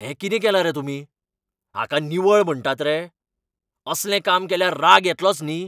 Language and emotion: Goan Konkani, angry